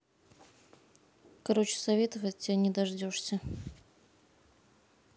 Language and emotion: Russian, neutral